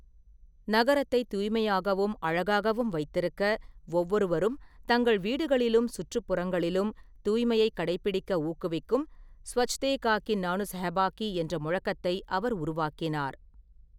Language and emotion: Tamil, neutral